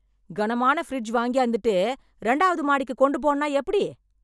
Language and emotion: Tamil, angry